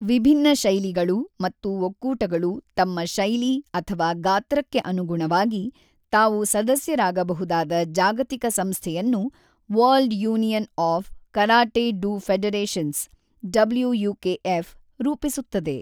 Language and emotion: Kannada, neutral